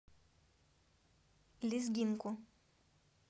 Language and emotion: Russian, neutral